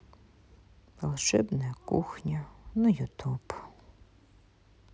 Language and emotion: Russian, sad